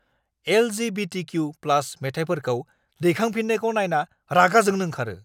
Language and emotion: Bodo, angry